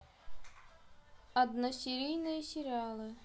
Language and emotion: Russian, neutral